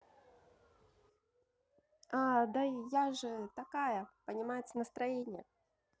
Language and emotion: Russian, positive